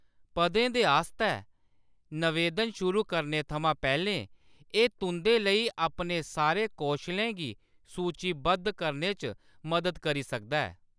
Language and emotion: Dogri, neutral